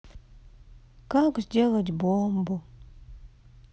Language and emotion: Russian, sad